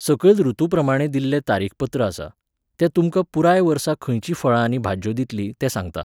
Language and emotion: Goan Konkani, neutral